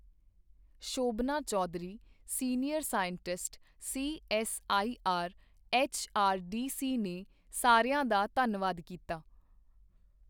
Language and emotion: Punjabi, neutral